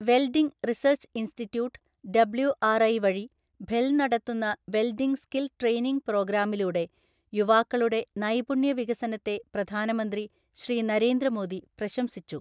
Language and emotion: Malayalam, neutral